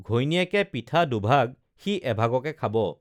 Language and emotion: Assamese, neutral